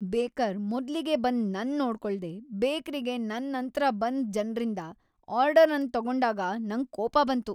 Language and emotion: Kannada, angry